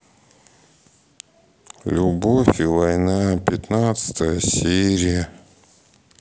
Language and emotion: Russian, sad